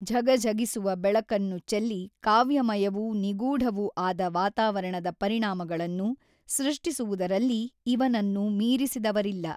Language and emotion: Kannada, neutral